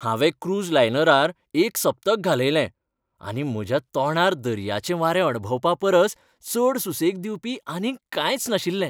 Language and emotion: Goan Konkani, happy